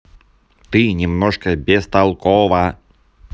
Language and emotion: Russian, angry